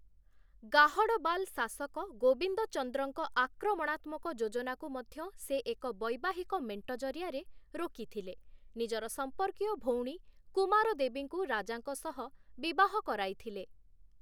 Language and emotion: Odia, neutral